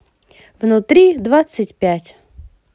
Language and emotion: Russian, positive